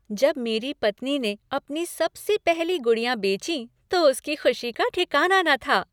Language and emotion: Hindi, happy